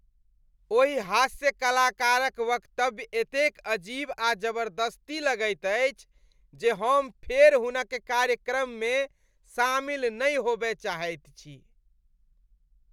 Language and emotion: Maithili, disgusted